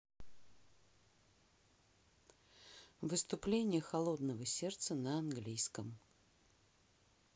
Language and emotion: Russian, neutral